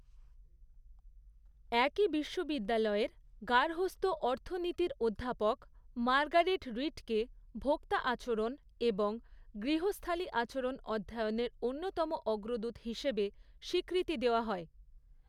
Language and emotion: Bengali, neutral